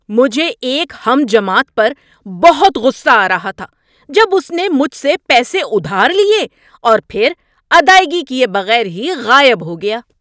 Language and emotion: Urdu, angry